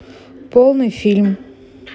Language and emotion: Russian, neutral